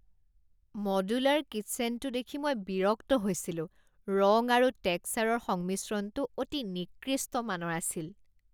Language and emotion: Assamese, disgusted